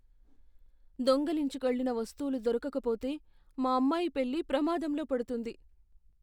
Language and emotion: Telugu, fearful